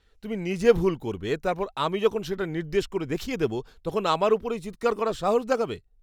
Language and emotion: Bengali, disgusted